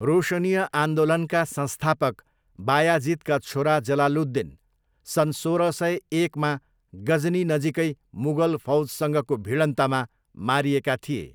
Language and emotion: Nepali, neutral